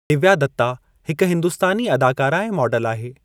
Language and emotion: Sindhi, neutral